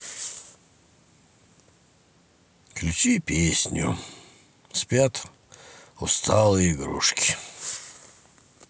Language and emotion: Russian, sad